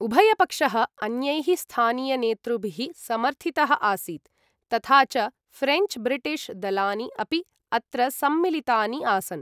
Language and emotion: Sanskrit, neutral